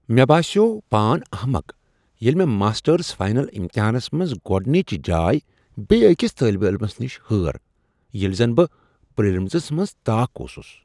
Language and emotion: Kashmiri, surprised